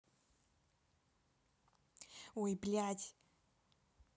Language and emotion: Russian, angry